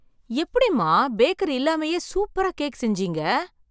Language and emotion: Tamil, surprised